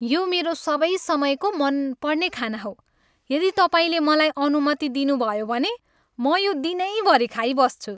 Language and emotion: Nepali, happy